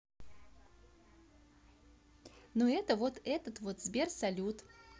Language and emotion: Russian, neutral